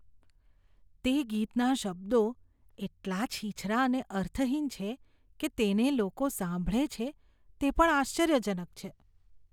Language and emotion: Gujarati, disgusted